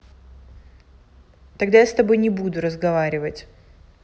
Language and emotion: Russian, angry